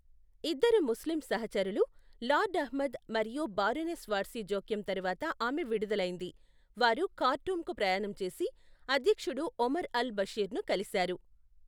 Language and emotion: Telugu, neutral